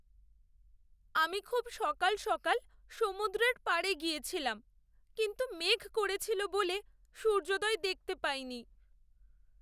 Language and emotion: Bengali, sad